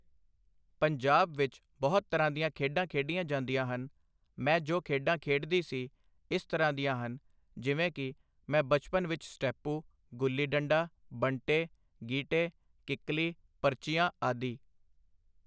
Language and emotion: Punjabi, neutral